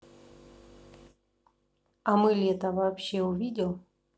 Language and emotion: Russian, neutral